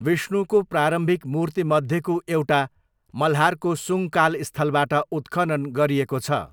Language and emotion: Nepali, neutral